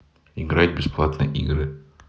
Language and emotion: Russian, neutral